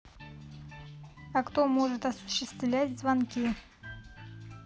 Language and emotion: Russian, neutral